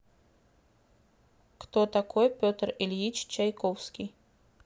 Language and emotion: Russian, neutral